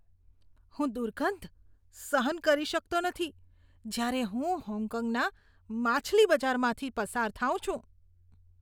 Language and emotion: Gujarati, disgusted